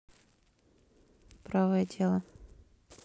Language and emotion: Russian, neutral